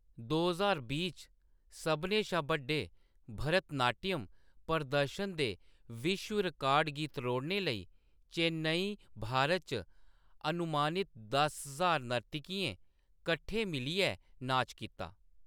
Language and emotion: Dogri, neutral